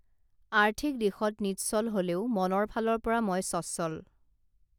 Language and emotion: Assamese, neutral